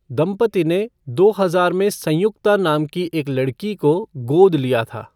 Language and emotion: Hindi, neutral